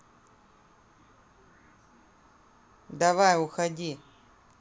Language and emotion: Russian, neutral